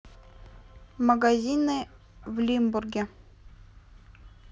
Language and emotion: Russian, neutral